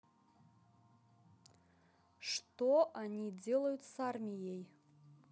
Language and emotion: Russian, neutral